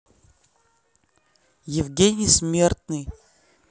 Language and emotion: Russian, neutral